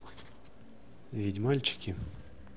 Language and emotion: Russian, neutral